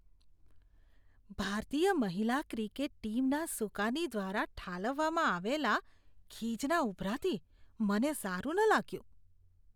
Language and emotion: Gujarati, disgusted